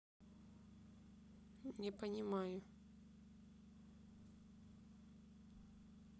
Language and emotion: Russian, neutral